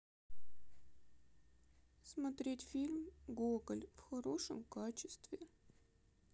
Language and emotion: Russian, sad